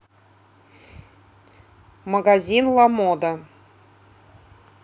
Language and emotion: Russian, neutral